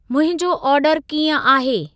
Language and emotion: Sindhi, neutral